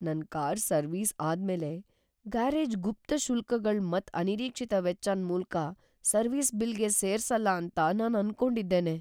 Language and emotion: Kannada, fearful